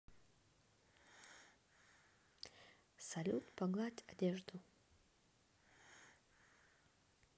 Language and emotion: Russian, neutral